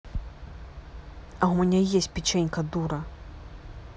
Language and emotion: Russian, angry